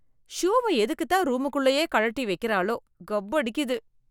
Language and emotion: Tamil, disgusted